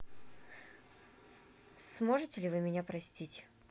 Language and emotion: Russian, neutral